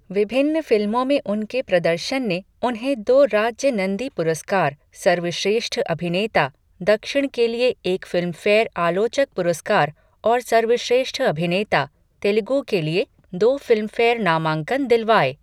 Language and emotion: Hindi, neutral